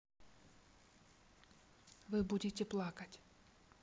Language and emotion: Russian, neutral